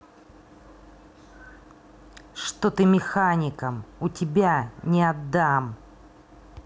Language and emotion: Russian, angry